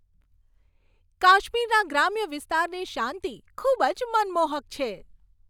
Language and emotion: Gujarati, happy